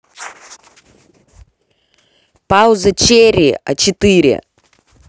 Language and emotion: Russian, angry